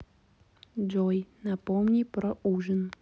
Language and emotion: Russian, neutral